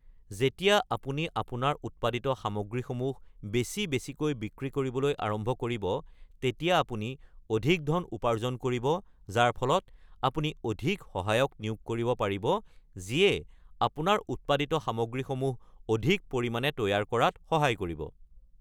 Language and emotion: Assamese, neutral